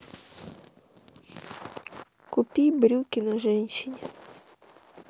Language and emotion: Russian, sad